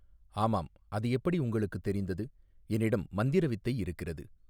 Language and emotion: Tamil, neutral